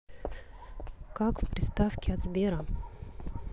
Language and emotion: Russian, neutral